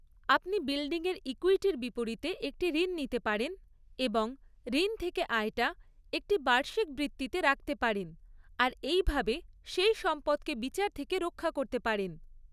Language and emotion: Bengali, neutral